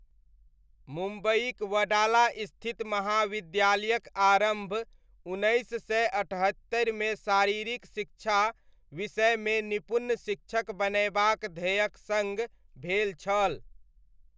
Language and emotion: Maithili, neutral